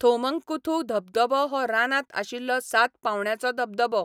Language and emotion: Goan Konkani, neutral